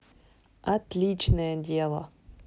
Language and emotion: Russian, positive